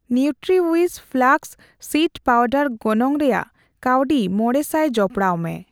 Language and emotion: Santali, neutral